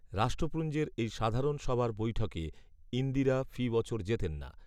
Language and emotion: Bengali, neutral